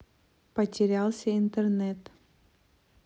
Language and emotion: Russian, neutral